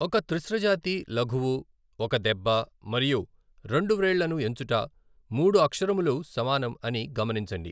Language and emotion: Telugu, neutral